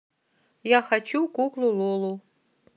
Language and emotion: Russian, neutral